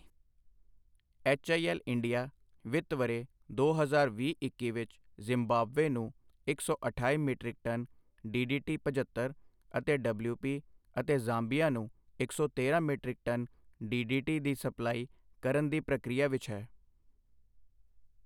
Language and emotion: Punjabi, neutral